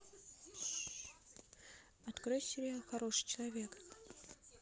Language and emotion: Russian, neutral